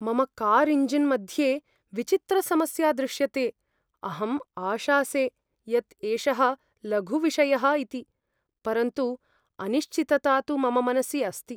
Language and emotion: Sanskrit, fearful